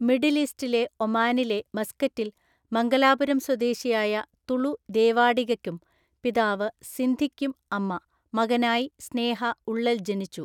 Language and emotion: Malayalam, neutral